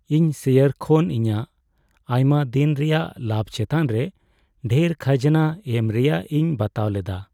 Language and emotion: Santali, sad